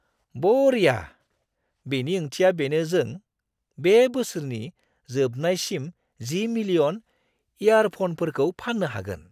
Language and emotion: Bodo, surprised